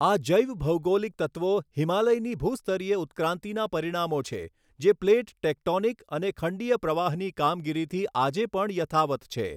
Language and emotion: Gujarati, neutral